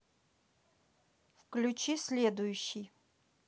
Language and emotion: Russian, neutral